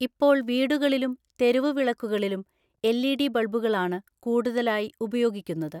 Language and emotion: Malayalam, neutral